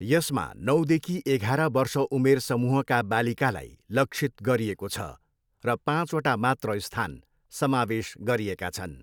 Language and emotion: Nepali, neutral